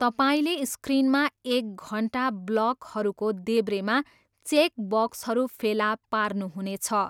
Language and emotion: Nepali, neutral